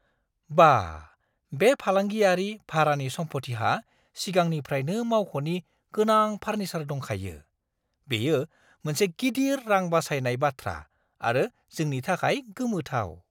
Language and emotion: Bodo, surprised